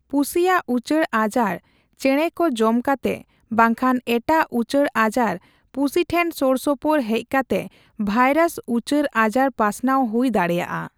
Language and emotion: Santali, neutral